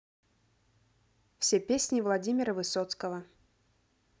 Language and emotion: Russian, neutral